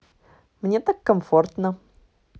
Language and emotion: Russian, positive